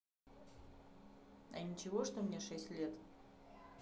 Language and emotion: Russian, neutral